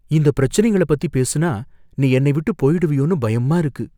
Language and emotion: Tamil, fearful